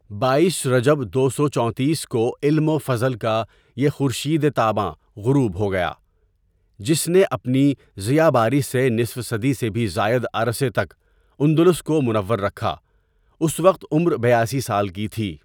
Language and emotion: Urdu, neutral